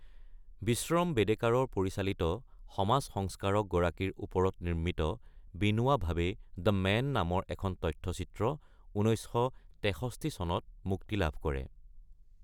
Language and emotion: Assamese, neutral